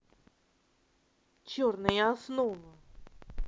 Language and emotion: Russian, angry